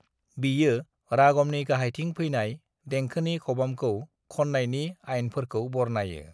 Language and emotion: Bodo, neutral